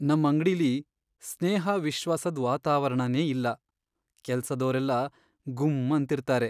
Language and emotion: Kannada, sad